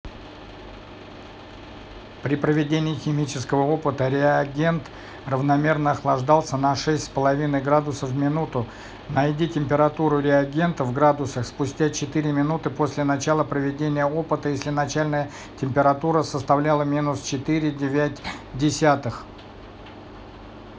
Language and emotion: Russian, neutral